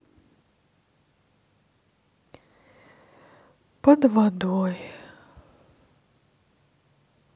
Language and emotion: Russian, sad